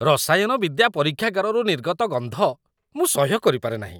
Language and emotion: Odia, disgusted